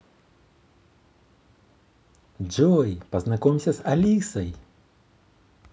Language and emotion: Russian, positive